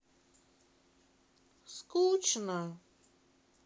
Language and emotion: Russian, sad